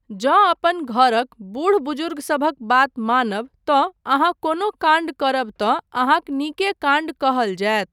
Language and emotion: Maithili, neutral